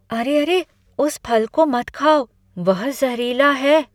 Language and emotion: Hindi, fearful